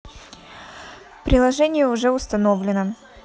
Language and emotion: Russian, neutral